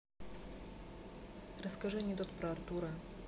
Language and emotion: Russian, neutral